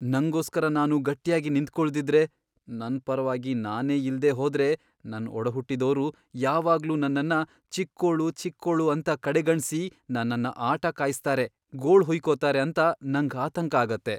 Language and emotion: Kannada, fearful